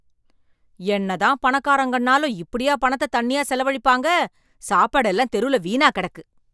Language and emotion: Tamil, angry